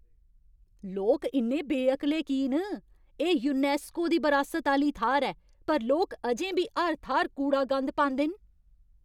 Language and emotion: Dogri, angry